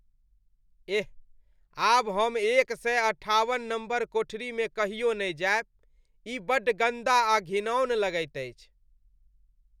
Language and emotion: Maithili, disgusted